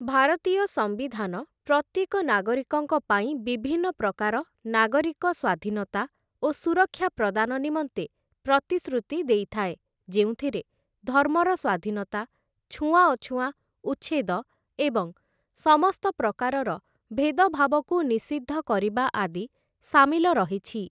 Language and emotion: Odia, neutral